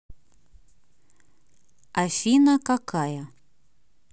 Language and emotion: Russian, neutral